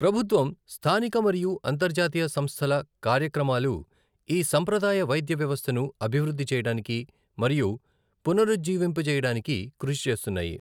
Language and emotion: Telugu, neutral